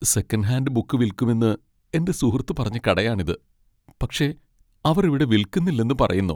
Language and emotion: Malayalam, sad